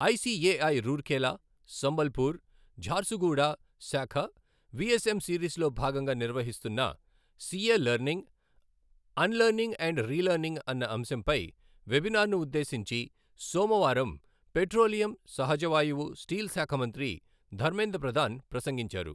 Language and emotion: Telugu, neutral